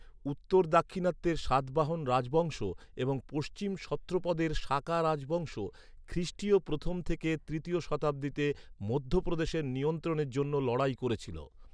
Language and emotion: Bengali, neutral